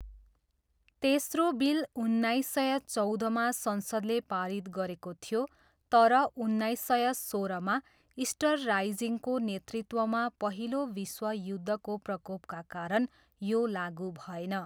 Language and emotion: Nepali, neutral